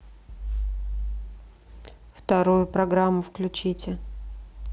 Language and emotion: Russian, neutral